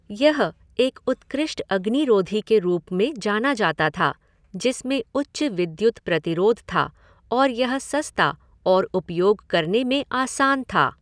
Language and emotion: Hindi, neutral